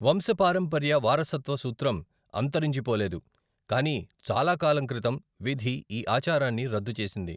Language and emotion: Telugu, neutral